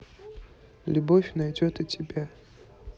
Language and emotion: Russian, neutral